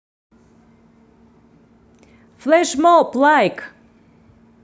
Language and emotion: Russian, positive